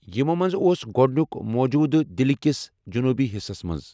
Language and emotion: Kashmiri, neutral